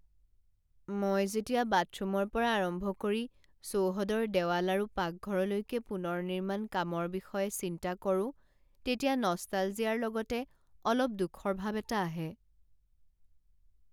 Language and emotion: Assamese, sad